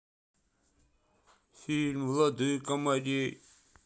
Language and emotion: Russian, sad